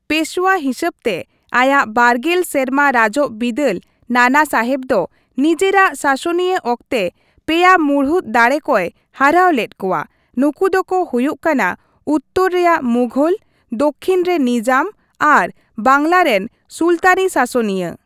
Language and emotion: Santali, neutral